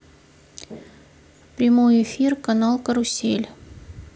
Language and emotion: Russian, neutral